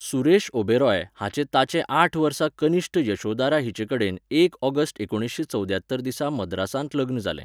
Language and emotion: Goan Konkani, neutral